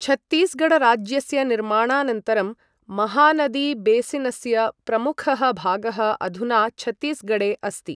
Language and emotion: Sanskrit, neutral